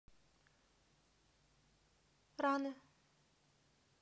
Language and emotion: Russian, neutral